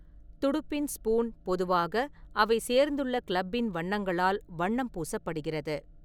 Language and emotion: Tamil, neutral